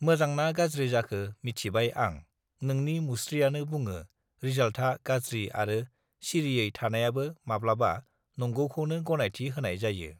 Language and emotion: Bodo, neutral